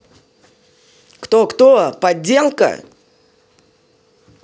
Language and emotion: Russian, angry